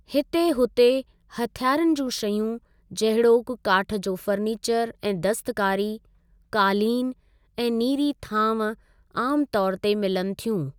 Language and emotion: Sindhi, neutral